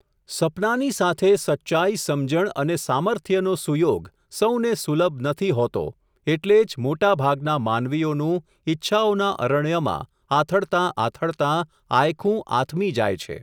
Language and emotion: Gujarati, neutral